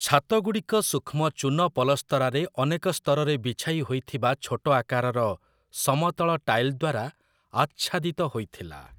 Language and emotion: Odia, neutral